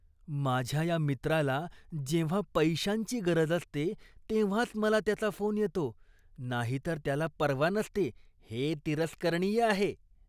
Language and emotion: Marathi, disgusted